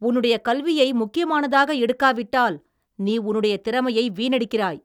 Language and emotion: Tamil, angry